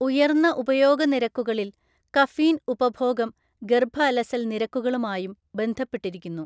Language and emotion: Malayalam, neutral